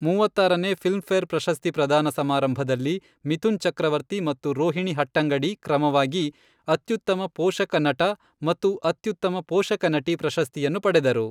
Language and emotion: Kannada, neutral